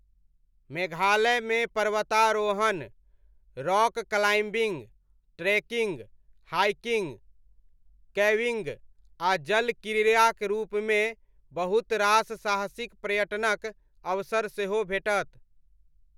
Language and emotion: Maithili, neutral